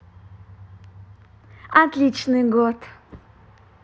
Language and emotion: Russian, positive